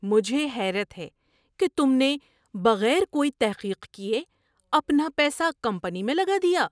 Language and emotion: Urdu, surprised